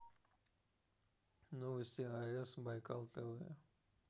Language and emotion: Russian, neutral